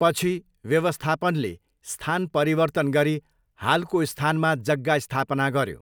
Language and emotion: Nepali, neutral